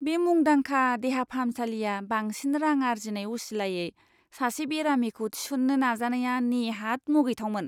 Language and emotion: Bodo, disgusted